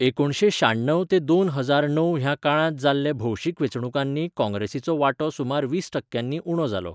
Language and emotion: Goan Konkani, neutral